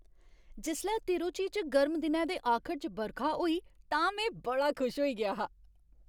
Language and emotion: Dogri, happy